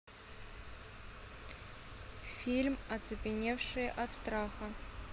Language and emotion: Russian, neutral